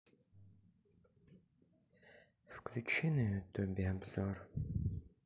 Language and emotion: Russian, sad